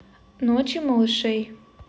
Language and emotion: Russian, neutral